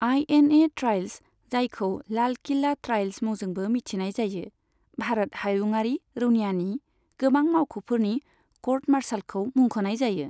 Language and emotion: Bodo, neutral